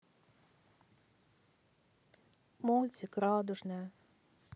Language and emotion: Russian, sad